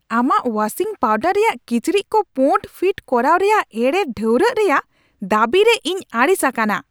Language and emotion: Santali, angry